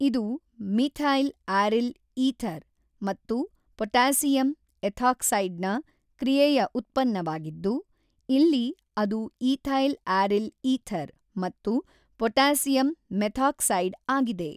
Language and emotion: Kannada, neutral